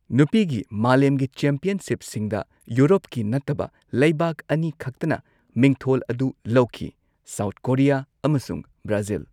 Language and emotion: Manipuri, neutral